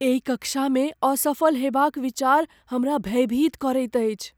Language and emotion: Maithili, fearful